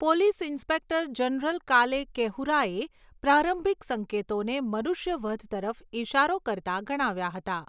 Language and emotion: Gujarati, neutral